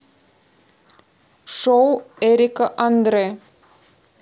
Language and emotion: Russian, neutral